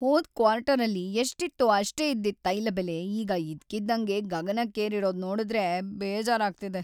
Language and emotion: Kannada, sad